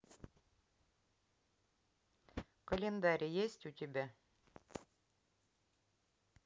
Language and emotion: Russian, neutral